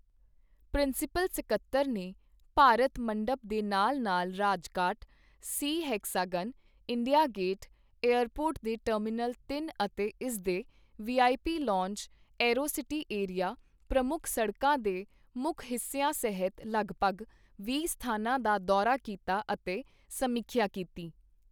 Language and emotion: Punjabi, neutral